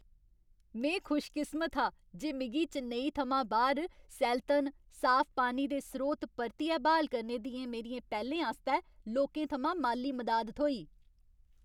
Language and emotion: Dogri, happy